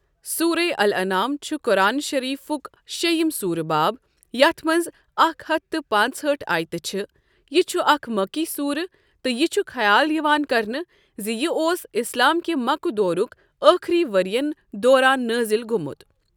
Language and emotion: Kashmiri, neutral